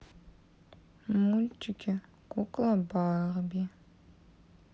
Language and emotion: Russian, sad